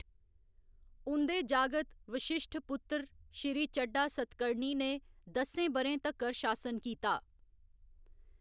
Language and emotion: Dogri, neutral